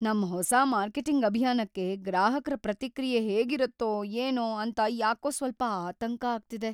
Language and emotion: Kannada, fearful